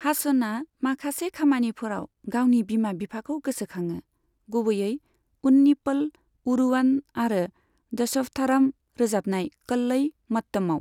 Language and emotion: Bodo, neutral